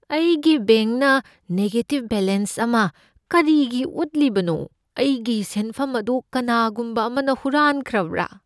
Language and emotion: Manipuri, fearful